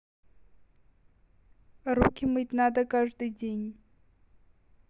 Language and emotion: Russian, neutral